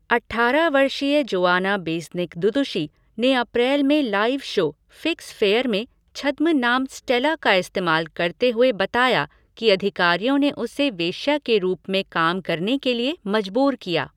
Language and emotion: Hindi, neutral